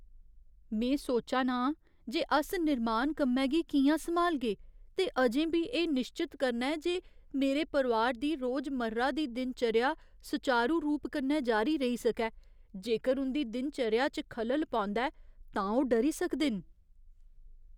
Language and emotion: Dogri, fearful